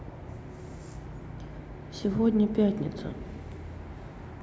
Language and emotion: Russian, neutral